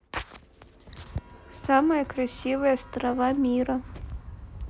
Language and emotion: Russian, neutral